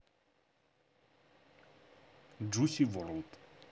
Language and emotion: Russian, neutral